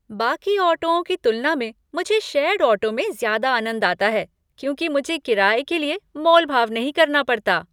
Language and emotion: Hindi, happy